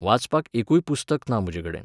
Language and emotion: Goan Konkani, neutral